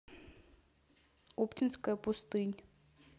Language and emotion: Russian, neutral